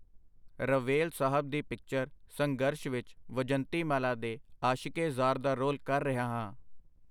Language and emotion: Punjabi, neutral